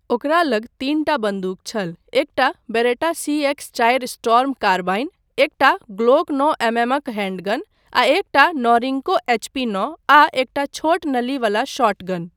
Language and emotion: Maithili, neutral